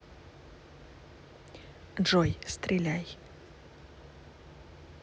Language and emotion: Russian, neutral